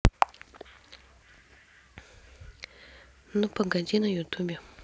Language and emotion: Russian, neutral